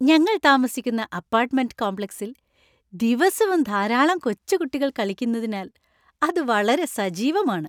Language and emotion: Malayalam, happy